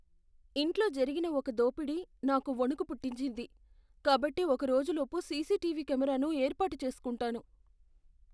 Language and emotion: Telugu, fearful